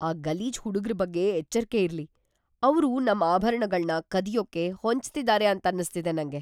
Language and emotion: Kannada, fearful